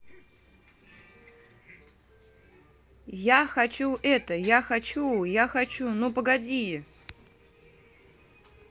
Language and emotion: Russian, neutral